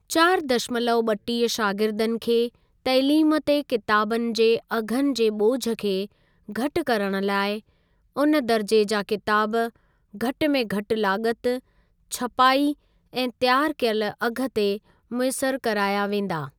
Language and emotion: Sindhi, neutral